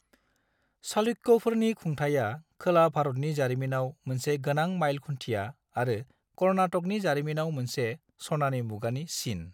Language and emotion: Bodo, neutral